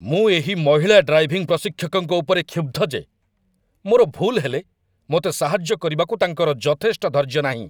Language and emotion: Odia, angry